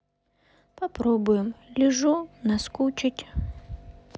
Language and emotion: Russian, sad